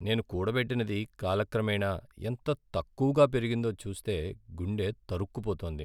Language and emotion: Telugu, sad